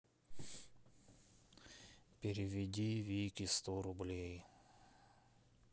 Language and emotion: Russian, sad